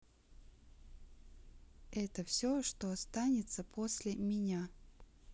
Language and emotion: Russian, neutral